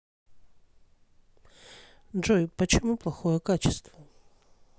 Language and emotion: Russian, neutral